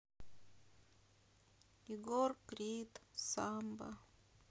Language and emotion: Russian, sad